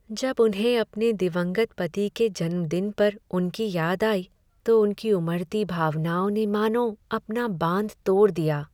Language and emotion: Hindi, sad